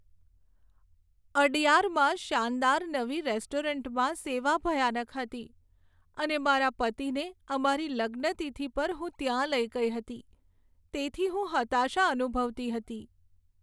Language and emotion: Gujarati, sad